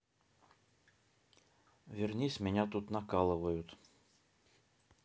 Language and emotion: Russian, neutral